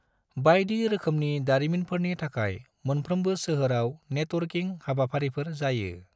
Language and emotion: Bodo, neutral